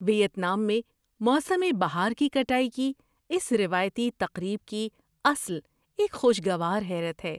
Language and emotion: Urdu, surprised